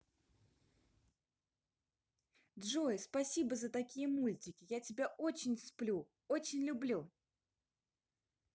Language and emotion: Russian, positive